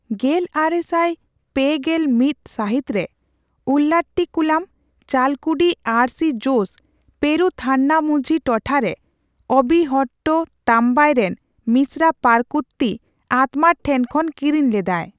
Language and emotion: Santali, neutral